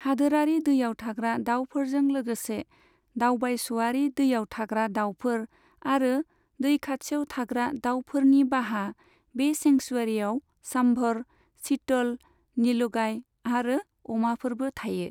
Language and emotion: Bodo, neutral